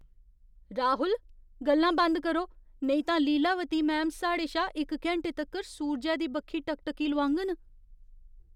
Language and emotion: Dogri, fearful